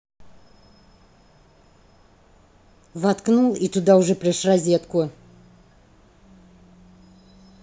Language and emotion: Russian, angry